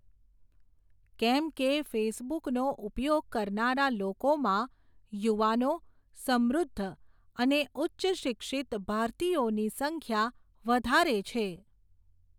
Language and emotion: Gujarati, neutral